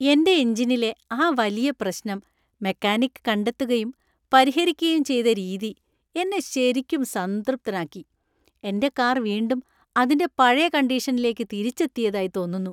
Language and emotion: Malayalam, happy